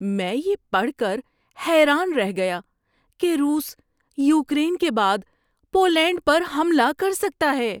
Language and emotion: Urdu, surprised